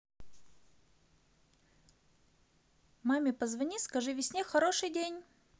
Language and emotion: Russian, positive